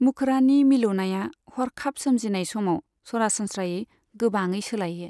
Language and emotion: Bodo, neutral